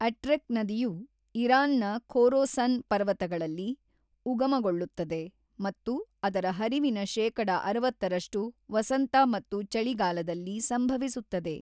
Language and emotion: Kannada, neutral